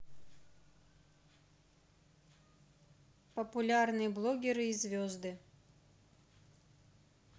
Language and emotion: Russian, neutral